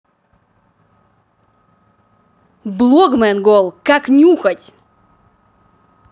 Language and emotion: Russian, angry